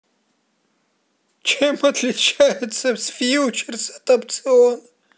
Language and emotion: Russian, positive